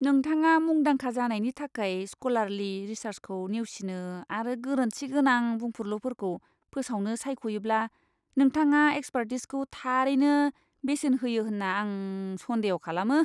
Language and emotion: Bodo, disgusted